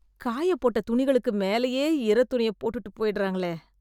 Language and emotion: Tamil, disgusted